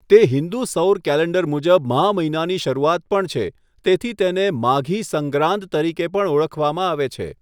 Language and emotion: Gujarati, neutral